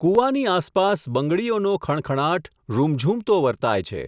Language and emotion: Gujarati, neutral